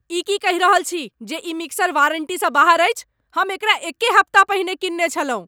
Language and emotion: Maithili, angry